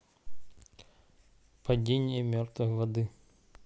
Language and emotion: Russian, neutral